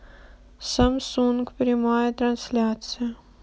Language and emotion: Russian, sad